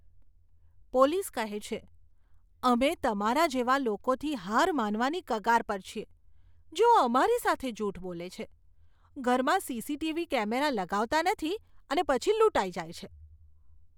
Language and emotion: Gujarati, disgusted